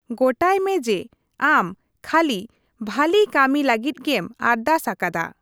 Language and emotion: Santali, neutral